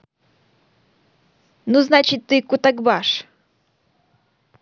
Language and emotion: Russian, neutral